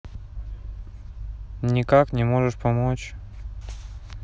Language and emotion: Russian, sad